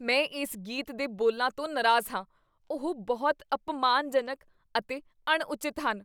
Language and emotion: Punjabi, disgusted